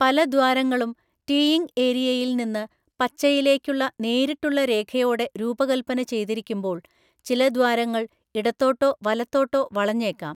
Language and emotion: Malayalam, neutral